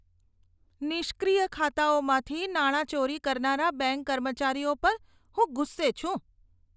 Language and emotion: Gujarati, disgusted